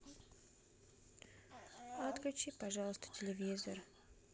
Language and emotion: Russian, sad